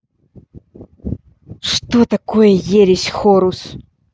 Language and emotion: Russian, angry